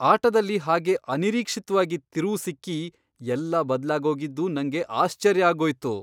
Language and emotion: Kannada, surprised